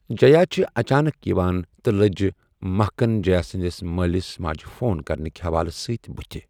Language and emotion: Kashmiri, neutral